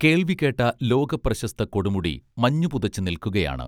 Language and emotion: Malayalam, neutral